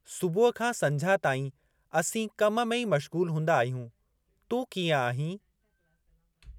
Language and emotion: Sindhi, neutral